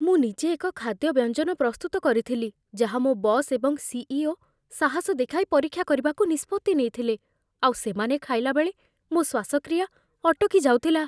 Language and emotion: Odia, fearful